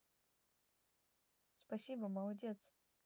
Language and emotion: Russian, neutral